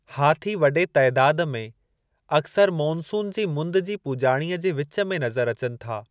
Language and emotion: Sindhi, neutral